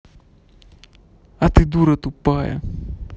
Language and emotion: Russian, angry